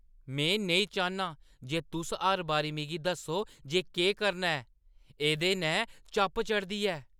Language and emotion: Dogri, angry